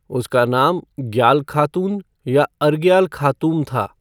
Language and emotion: Hindi, neutral